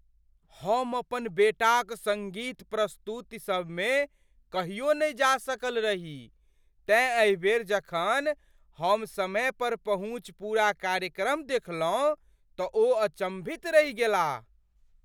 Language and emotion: Maithili, surprised